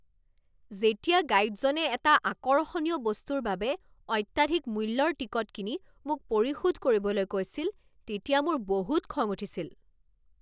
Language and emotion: Assamese, angry